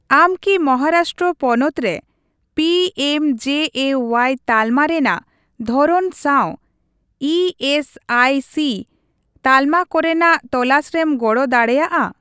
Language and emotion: Santali, neutral